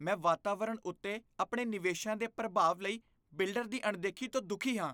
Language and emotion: Punjabi, disgusted